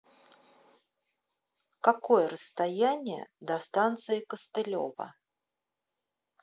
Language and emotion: Russian, neutral